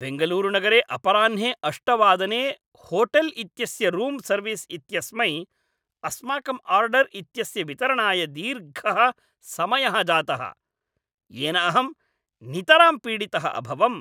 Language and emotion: Sanskrit, angry